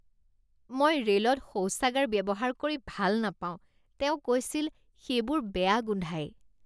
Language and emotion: Assamese, disgusted